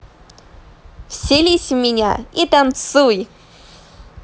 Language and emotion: Russian, positive